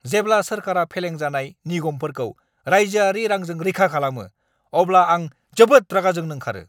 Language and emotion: Bodo, angry